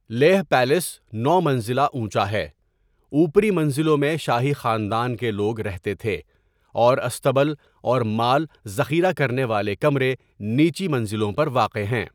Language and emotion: Urdu, neutral